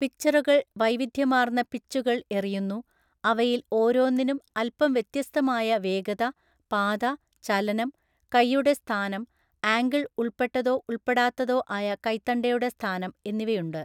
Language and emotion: Malayalam, neutral